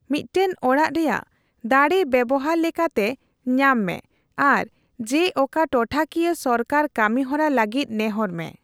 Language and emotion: Santali, neutral